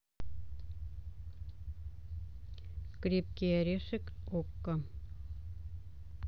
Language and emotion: Russian, neutral